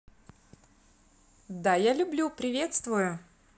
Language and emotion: Russian, positive